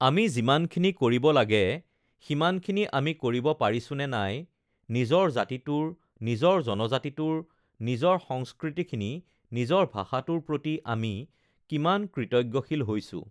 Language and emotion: Assamese, neutral